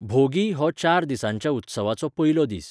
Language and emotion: Goan Konkani, neutral